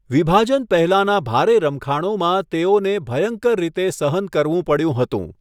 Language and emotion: Gujarati, neutral